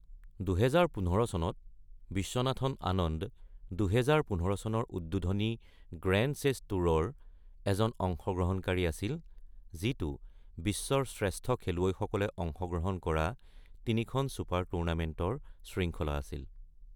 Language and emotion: Assamese, neutral